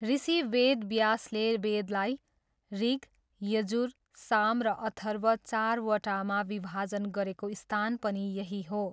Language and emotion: Nepali, neutral